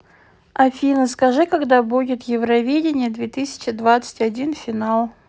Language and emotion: Russian, neutral